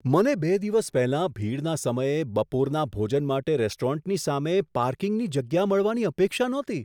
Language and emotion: Gujarati, surprised